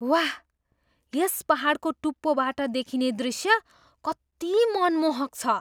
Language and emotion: Nepali, surprised